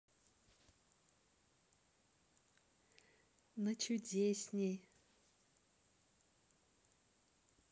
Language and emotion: Russian, positive